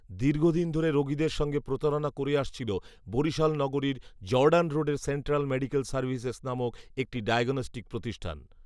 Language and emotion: Bengali, neutral